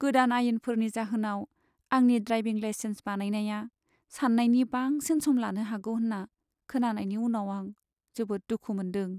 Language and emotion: Bodo, sad